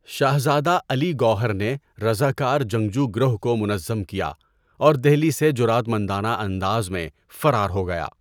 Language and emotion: Urdu, neutral